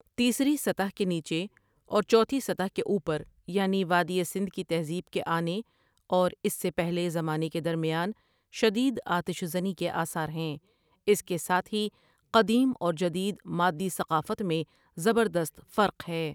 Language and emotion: Urdu, neutral